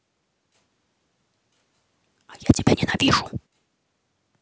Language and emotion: Russian, angry